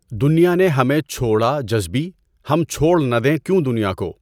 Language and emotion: Urdu, neutral